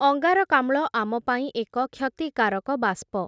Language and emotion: Odia, neutral